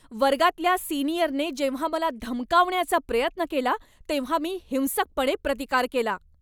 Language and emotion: Marathi, angry